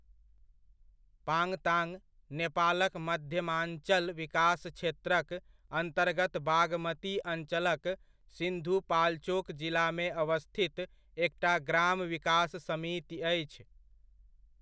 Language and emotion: Maithili, neutral